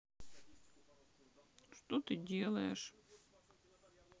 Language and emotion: Russian, sad